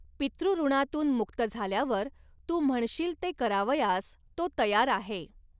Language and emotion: Marathi, neutral